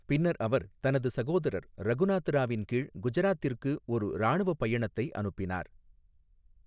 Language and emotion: Tamil, neutral